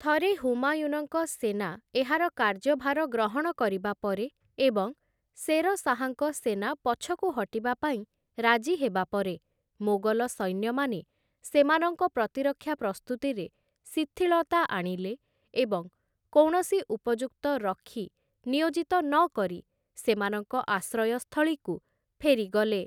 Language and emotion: Odia, neutral